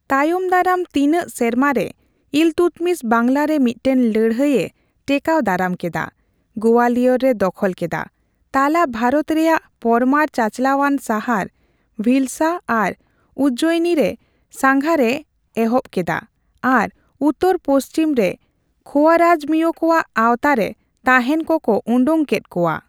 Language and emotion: Santali, neutral